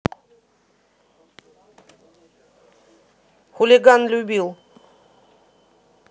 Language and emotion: Russian, neutral